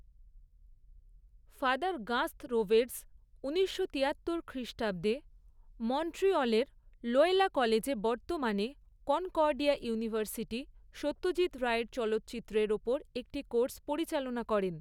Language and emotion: Bengali, neutral